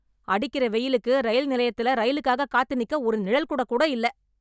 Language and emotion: Tamil, angry